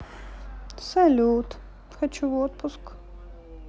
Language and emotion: Russian, sad